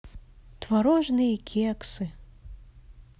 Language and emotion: Russian, neutral